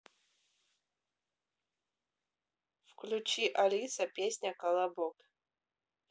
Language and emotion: Russian, neutral